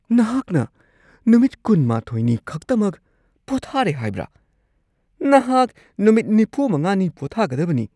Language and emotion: Manipuri, surprised